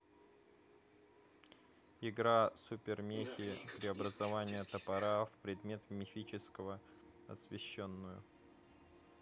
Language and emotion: Russian, neutral